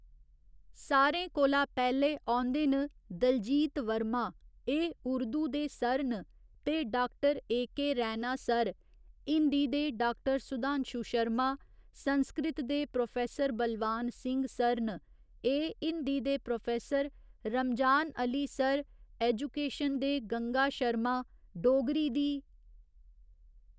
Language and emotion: Dogri, neutral